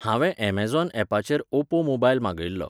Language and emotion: Goan Konkani, neutral